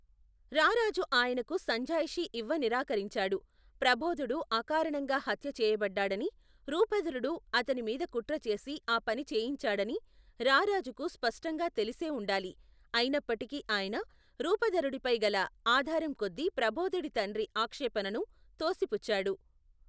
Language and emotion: Telugu, neutral